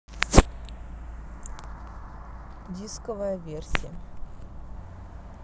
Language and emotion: Russian, neutral